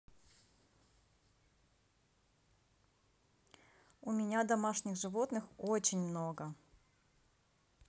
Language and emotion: Russian, neutral